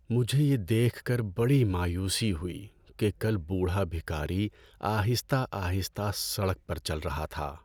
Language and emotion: Urdu, sad